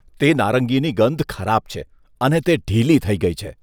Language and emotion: Gujarati, disgusted